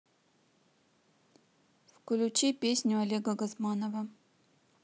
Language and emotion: Russian, neutral